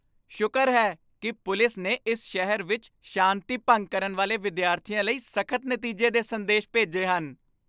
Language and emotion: Punjabi, happy